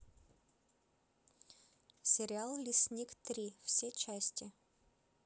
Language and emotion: Russian, neutral